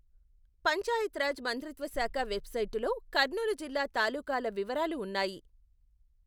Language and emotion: Telugu, neutral